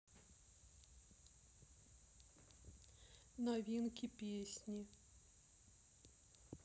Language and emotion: Russian, sad